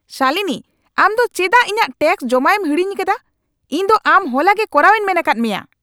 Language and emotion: Santali, angry